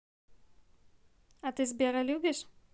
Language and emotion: Russian, neutral